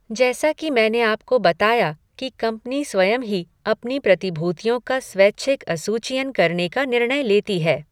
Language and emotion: Hindi, neutral